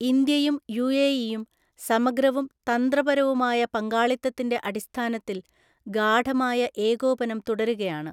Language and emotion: Malayalam, neutral